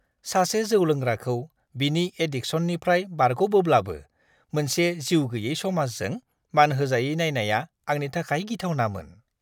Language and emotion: Bodo, disgusted